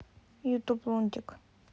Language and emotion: Russian, neutral